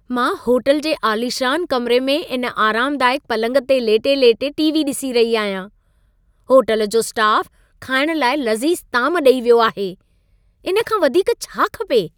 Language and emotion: Sindhi, happy